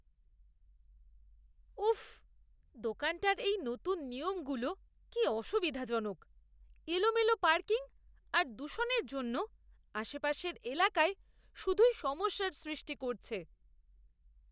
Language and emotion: Bengali, disgusted